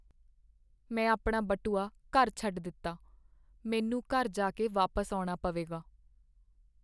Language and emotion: Punjabi, sad